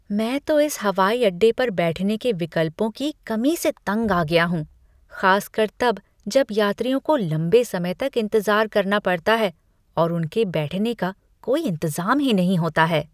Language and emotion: Hindi, disgusted